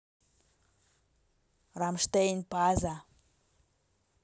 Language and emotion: Russian, neutral